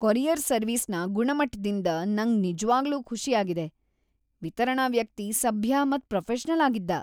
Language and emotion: Kannada, happy